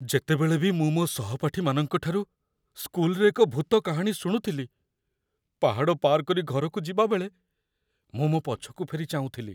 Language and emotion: Odia, fearful